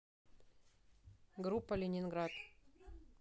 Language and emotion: Russian, neutral